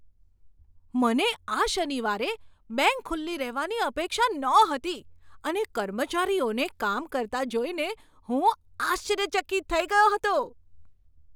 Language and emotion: Gujarati, surprised